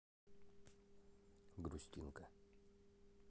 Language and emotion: Russian, sad